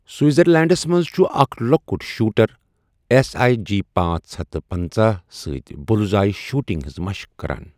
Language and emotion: Kashmiri, neutral